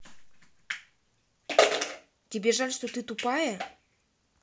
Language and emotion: Russian, angry